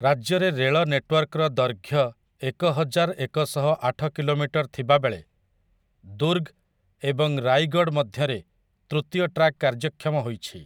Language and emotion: Odia, neutral